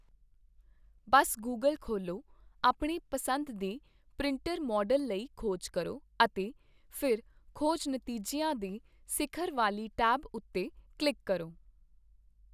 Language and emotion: Punjabi, neutral